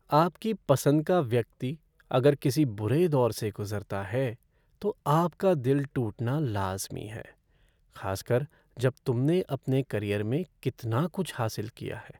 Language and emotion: Hindi, sad